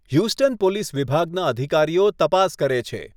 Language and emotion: Gujarati, neutral